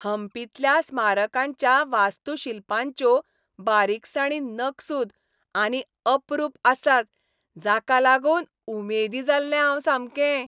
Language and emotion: Goan Konkani, happy